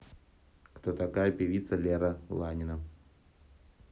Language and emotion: Russian, neutral